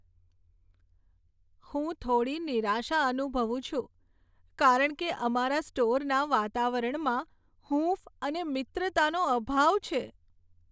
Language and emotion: Gujarati, sad